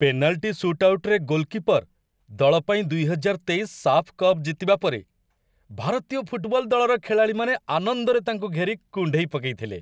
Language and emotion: Odia, happy